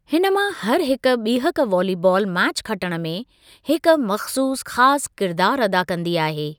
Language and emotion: Sindhi, neutral